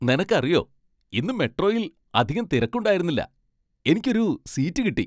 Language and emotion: Malayalam, happy